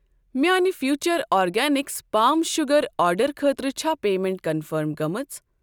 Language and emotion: Kashmiri, neutral